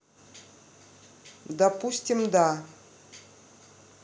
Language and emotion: Russian, neutral